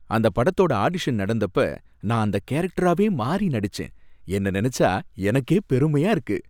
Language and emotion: Tamil, happy